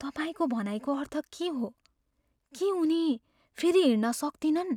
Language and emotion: Nepali, fearful